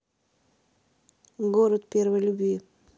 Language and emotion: Russian, neutral